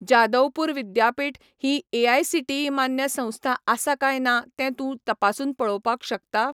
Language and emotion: Goan Konkani, neutral